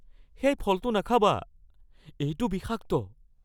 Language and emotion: Assamese, fearful